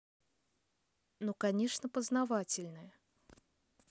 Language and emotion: Russian, neutral